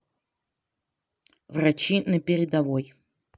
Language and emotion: Russian, neutral